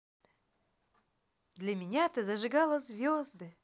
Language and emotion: Russian, positive